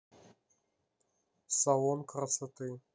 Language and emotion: Russian, neutral